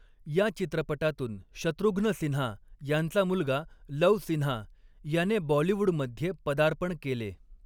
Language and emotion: Marathi, neutral